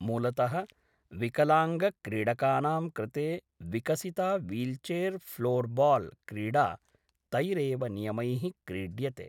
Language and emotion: Sanskrit, neutral